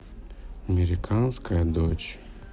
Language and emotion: Russian, sad